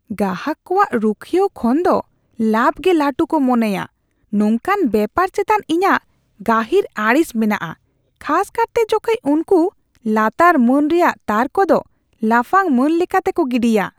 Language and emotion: Santali, disgusted